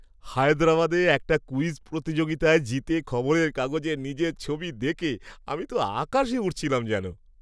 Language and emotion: Bengali, happy